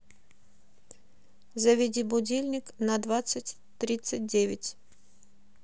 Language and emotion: Russian, neutral